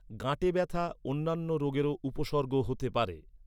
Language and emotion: Bengali, neutral